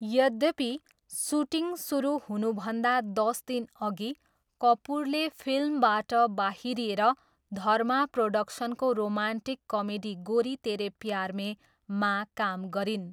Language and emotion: Nepali, neutral